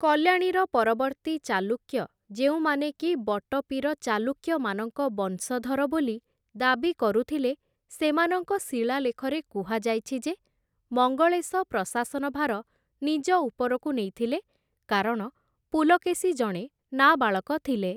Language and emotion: Odia, neutral